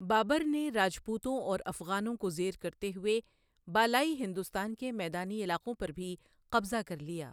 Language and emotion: Urdu, neutral